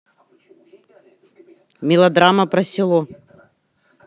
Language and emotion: Russian, neutral